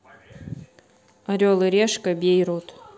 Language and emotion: Russian, neutral